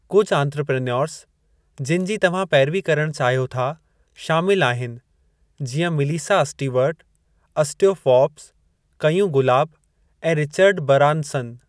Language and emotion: Sindhi, neutral